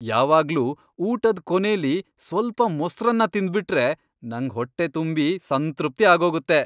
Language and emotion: Kannada, happy